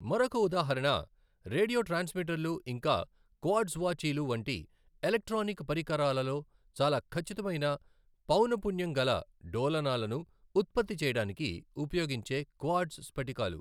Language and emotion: Telugu, neutral